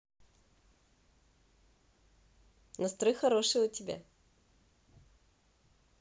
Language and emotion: Russian, positive